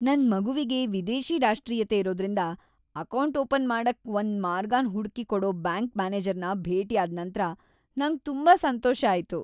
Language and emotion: Kannada, happy